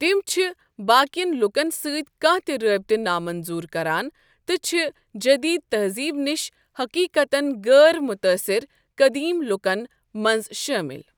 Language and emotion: Kashmiri, neutral